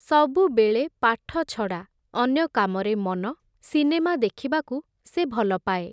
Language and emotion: Odia, neutral